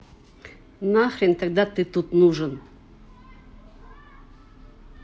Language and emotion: Russian, angry